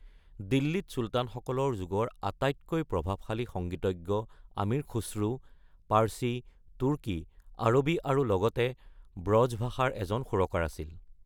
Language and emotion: Assamese, neutral